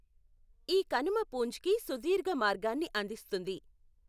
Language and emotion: Telugu, neutral